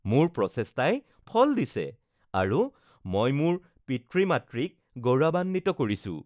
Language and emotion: Assamese, happy